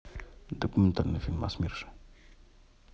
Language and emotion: Russian, neutral